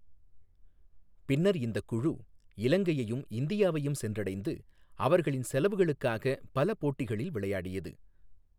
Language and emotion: Tamil, neutral